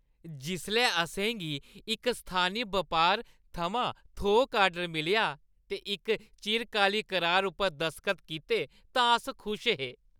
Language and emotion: Dogri, happy